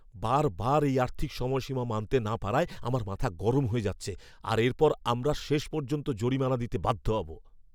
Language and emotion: Bengali, angry